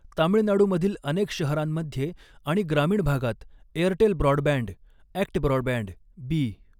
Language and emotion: Marathi, neutral